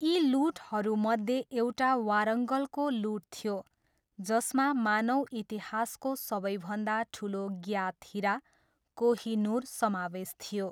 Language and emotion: Nepali, neutral